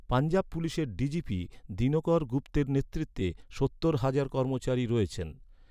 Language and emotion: Bengali, neutral